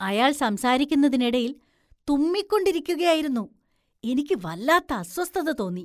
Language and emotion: Malayalam, disgusted